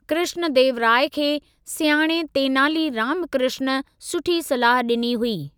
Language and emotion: Sindhi, neutral